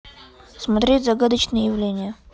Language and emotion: Russian, neutral